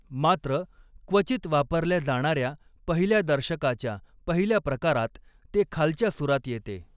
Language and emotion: Marathi, neutral